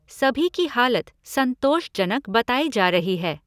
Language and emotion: Hindi, neutral